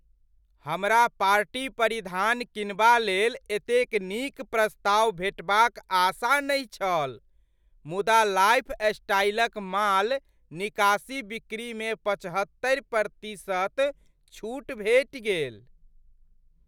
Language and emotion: Maithili, surprised